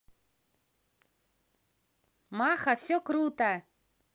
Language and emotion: Russian, positive